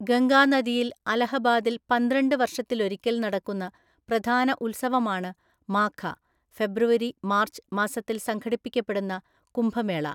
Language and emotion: Malayalam, neutral